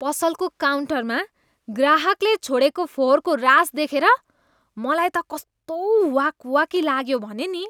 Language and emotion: Nepali, disgusted